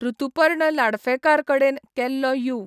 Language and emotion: Goan Konkani, neutral